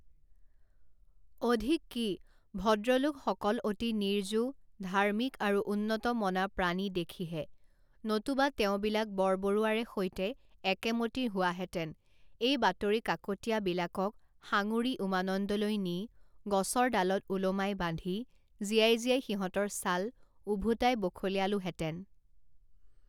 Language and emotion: Assamese, neutral